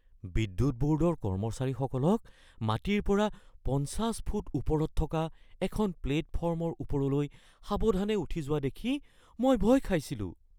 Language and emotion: Assamese, fearful